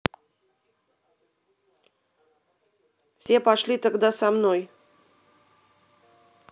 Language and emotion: Russian, angry